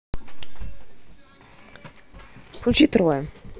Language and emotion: Russian, neutral